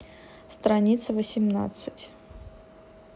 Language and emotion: Russian, neutral